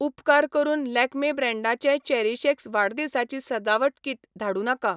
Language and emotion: Goan Konkani, neutral